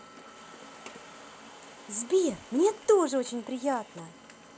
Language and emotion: Russian, positive